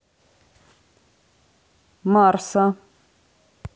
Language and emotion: Russian, neutral